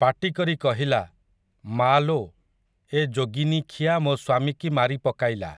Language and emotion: Odia, neutral